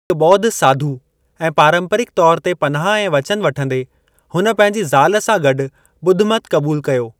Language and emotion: Sindhi, neutral